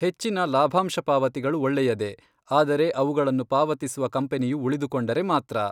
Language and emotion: Kannada, neutral